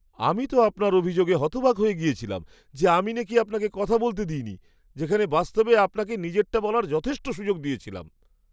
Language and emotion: Bengali, surprised